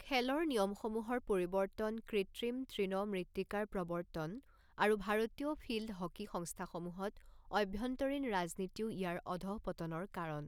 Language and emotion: Assamese, neutral